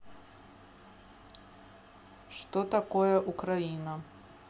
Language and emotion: Russian, neutral